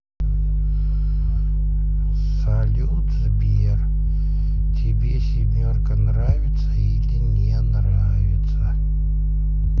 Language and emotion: Russian, neutral